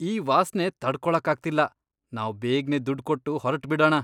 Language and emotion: Kannada, disgusted